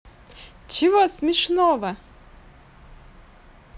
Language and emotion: Russian, positive